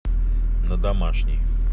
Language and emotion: Russian, neutral